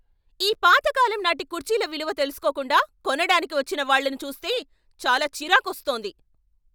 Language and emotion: Telugu, angry